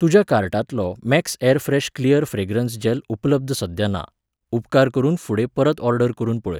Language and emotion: Goan Konkani, neutral